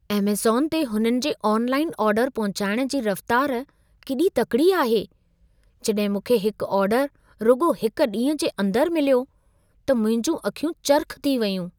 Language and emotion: Sindhi, surprised